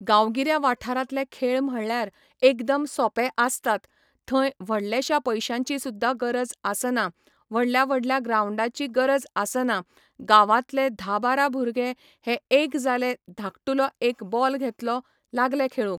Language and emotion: Goan Konkani, neutral